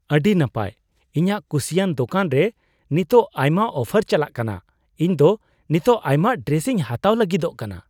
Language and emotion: Santali, surprised